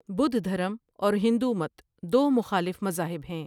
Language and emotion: Urdu, neutral